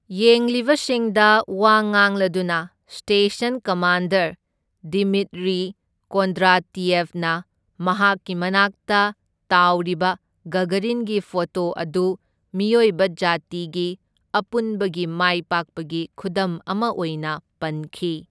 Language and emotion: Manipuri, neutral